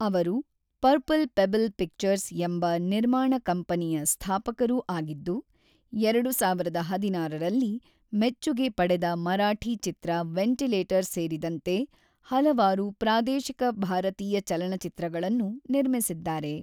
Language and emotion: Kannada, neutral